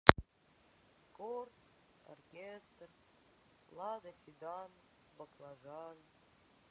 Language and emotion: Russian, sad